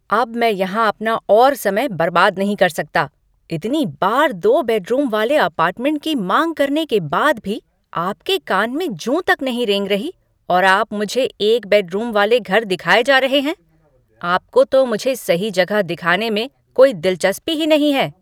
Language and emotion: Hindi, angry